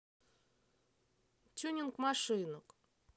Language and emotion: Russian, neutral